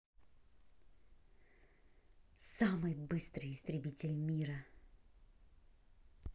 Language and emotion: Russian, neutral